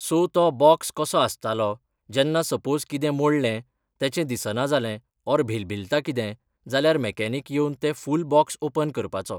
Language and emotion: Goan Konkani, neutral